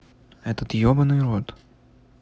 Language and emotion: Russian, neutral